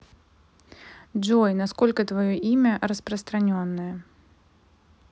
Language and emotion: Russian, neutral